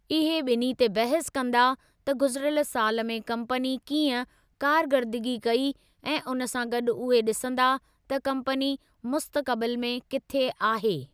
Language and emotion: Sindhi, neutral